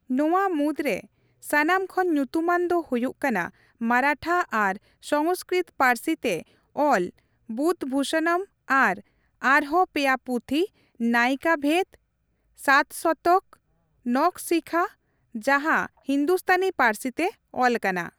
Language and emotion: Santali, neutral